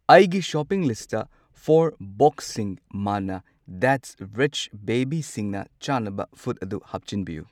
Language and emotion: Manipuri, neutral